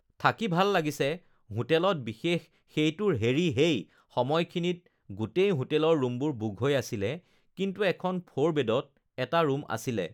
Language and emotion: Assamese, neutral